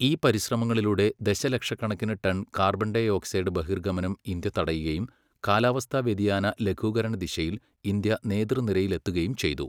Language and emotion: Malayalam, neutral